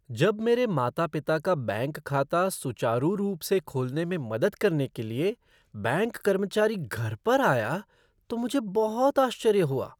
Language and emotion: Hindi, surprised